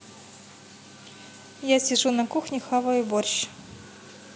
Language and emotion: Russian, neutral